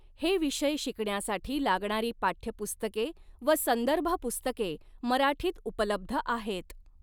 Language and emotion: Marathi, neutral